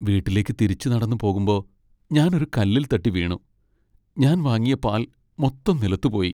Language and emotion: Malayalam, sad